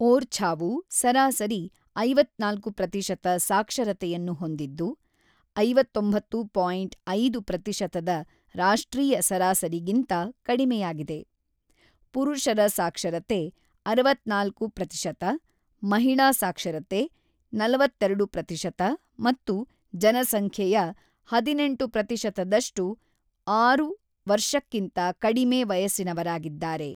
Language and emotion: Kannada, neutral